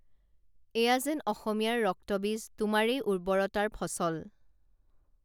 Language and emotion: Assamese, neutral